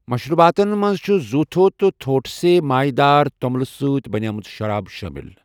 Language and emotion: Kashmiri, neutral